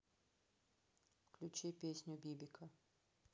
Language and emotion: Russian, neutral